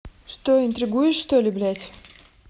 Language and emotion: Russian, angry